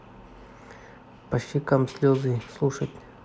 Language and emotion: Russian, neutral